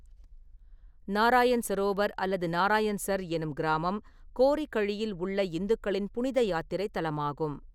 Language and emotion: Tamil, neutral